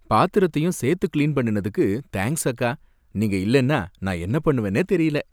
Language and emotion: Tamil, happy